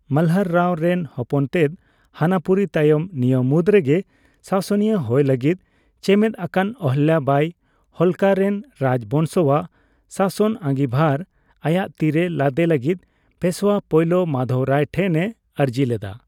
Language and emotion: Santali, neutral